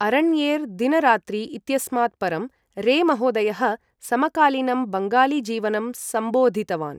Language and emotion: Sanskrit, neutral